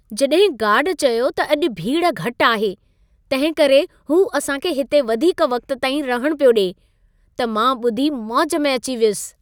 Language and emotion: Sindhi, happy